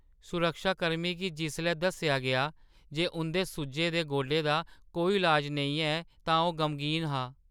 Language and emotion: Dogri, sad